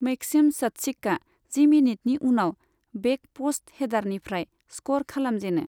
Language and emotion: Bodo, neutral